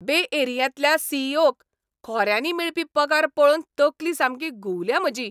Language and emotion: Goan Konkani, angry